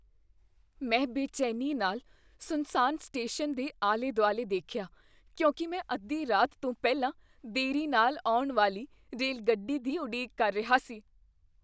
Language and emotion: Punjabi, fearful